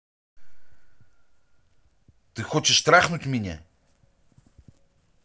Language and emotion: Russian, angry